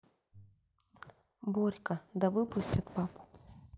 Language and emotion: Russian, neutral